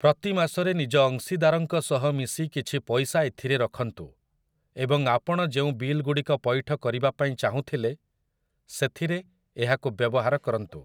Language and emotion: Odia, neutral